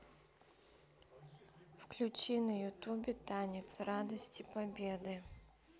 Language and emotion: Russian, neutral